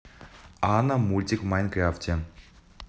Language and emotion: Russian, neutral